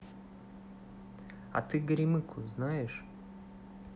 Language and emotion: Russian, neutral